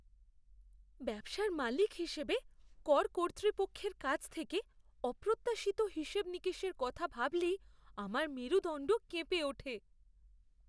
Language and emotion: Bengali, fearful